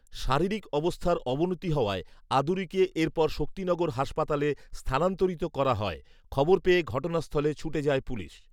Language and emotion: Bengali, neutral